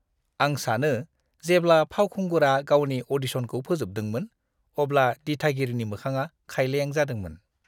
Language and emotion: Bodo, disgusted